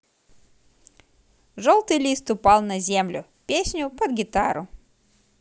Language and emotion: Russian, positive